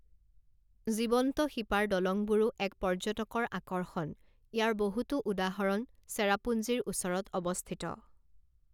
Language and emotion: Assamese, neutral